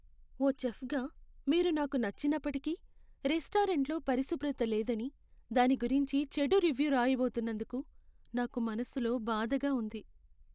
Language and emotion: Telugu, sad